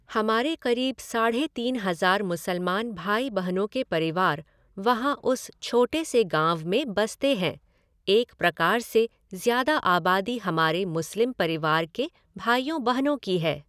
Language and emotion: Hindi, neutral